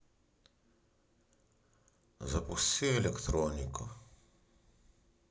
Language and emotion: Russian, sad